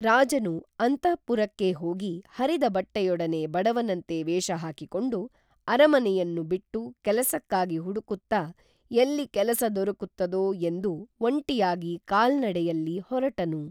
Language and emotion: Kannada, neutral